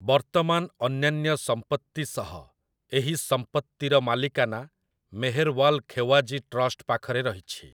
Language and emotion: Odia, neutral